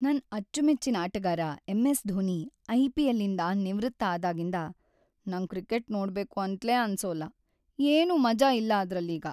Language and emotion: Kannada, sad